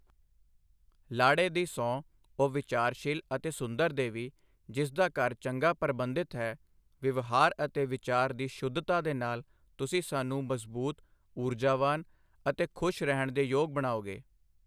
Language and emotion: Punjabi, neutral